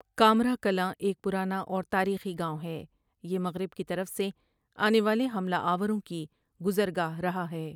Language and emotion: Urdu, neutral